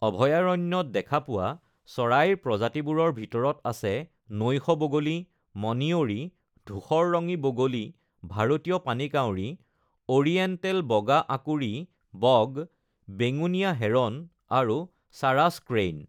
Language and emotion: Assamese, neutral